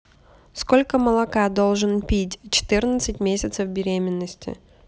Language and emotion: Russian, neutral